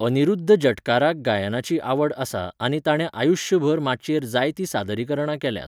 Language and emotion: Goan Konkani, neutral